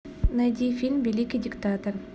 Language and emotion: Russian, neutral